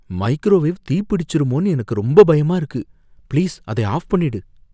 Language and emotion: Tamil, fearful